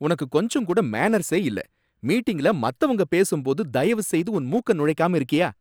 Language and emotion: Tamil, angry